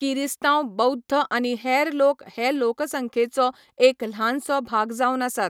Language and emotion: Goan Konkani, neutral